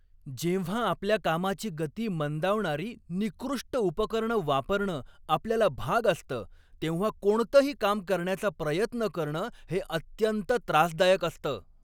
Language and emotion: Marathi, angry